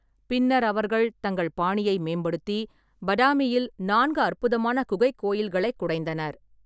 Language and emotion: Tamil, neutral